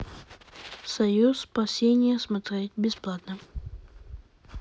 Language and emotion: Russian, neutral